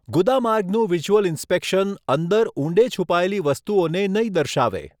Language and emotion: Gujarati, neutral